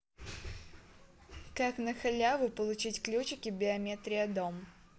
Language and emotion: Russian, neutral